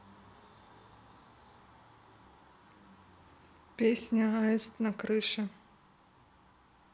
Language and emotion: Russian, neutral